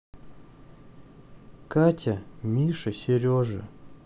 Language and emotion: Russian, sad